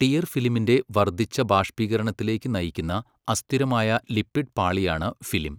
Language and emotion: Malayalam, neutral